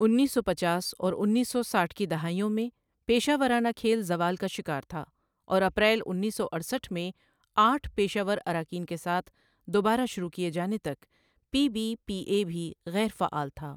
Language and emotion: Urdu, neutral